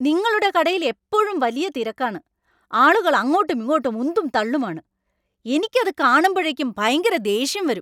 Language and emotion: Malayalam, angry